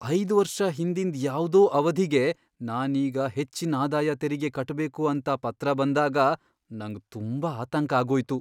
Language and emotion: Kannada, fearful